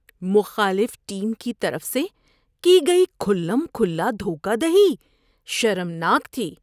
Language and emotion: Urdu, disgusted